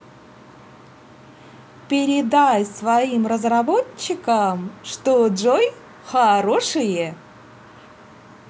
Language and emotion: Russian, positive